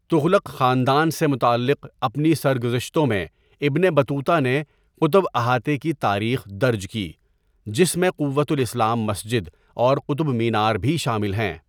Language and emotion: Urdu, neutral